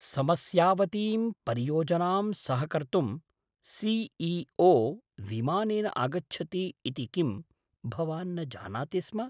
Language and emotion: Sanskrit, surprised